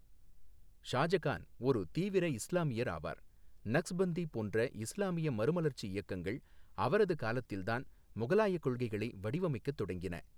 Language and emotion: Tamil, neutral